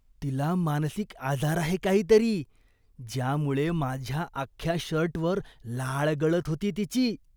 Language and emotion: Marathi, disgusted